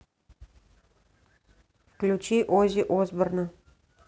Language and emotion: Russian, neutral